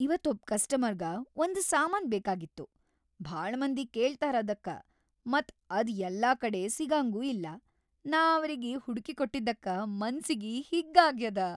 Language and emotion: Kannada, happy